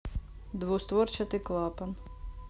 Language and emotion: Russian, neutral